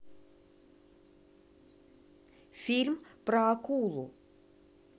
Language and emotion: Russian, neutral